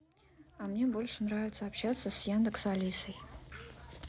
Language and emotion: Russian, neutral